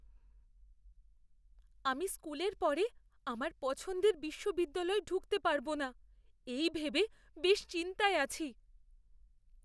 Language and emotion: Bengali, fearful